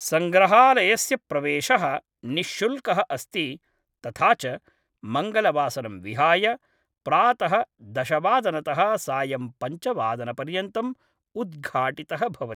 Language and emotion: Sanskrit, neutral